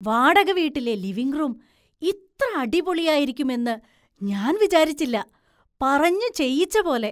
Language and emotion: Malayalam, surprised